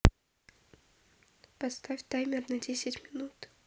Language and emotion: Russian, neutral